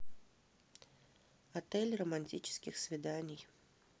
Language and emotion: Russian, neutral